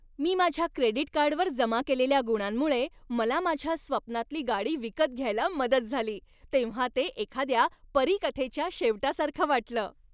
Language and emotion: Marathi, happy